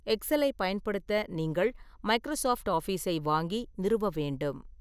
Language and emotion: Tamil, neutral